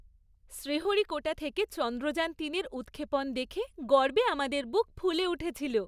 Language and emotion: Bengali, happy